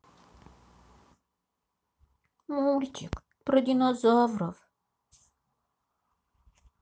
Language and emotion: Russian, sad